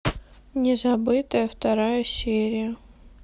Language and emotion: Russian, sad